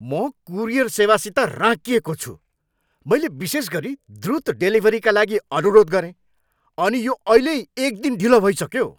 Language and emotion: Nepali, angry